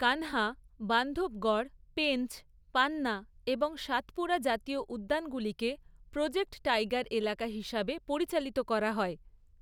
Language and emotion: Bengali, neutral